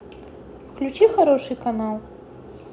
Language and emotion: Russian, neutral